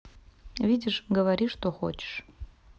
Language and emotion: Russian, neutral